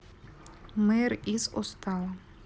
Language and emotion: Russian, neutral